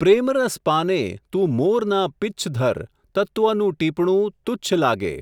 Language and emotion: Gujarati, neutral